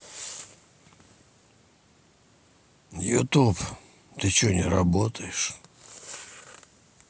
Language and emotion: Russian, angry